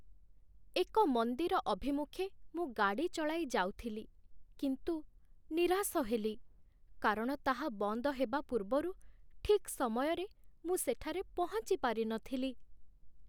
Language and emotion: Odia, sad